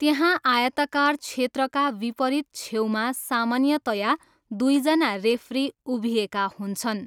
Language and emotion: Nepali, neutral